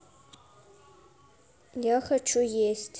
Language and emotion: Russian, neutral